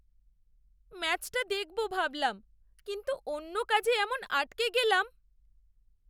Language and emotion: Bengali, sad